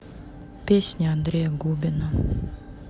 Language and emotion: Russian, neutral